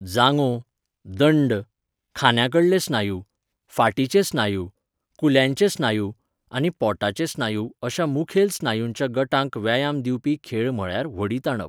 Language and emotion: Goan Konkani, neutral